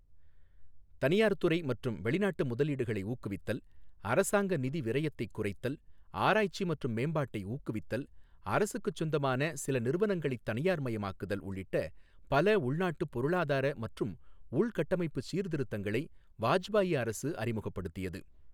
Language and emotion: Tamil, neutral